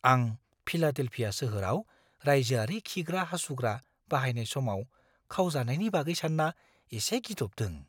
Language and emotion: Bodo, fearful